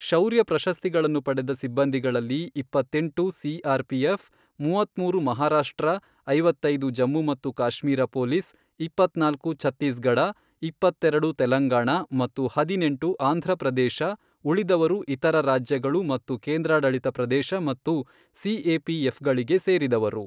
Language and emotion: Kannada, neutral